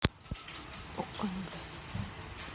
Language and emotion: Russian, neutral